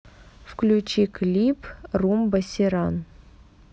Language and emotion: Russian, neutral